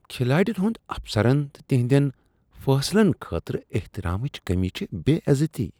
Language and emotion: Kashmiri, disgusted